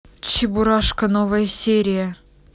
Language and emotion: Russian, angry